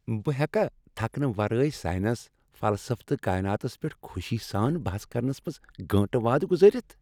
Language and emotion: Kashmiri, happy